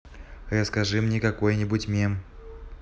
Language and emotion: Russian, neutral